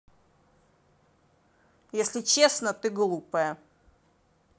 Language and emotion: Russian, angry